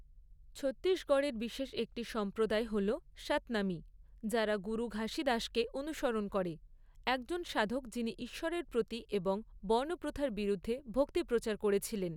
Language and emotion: Bengali, neutral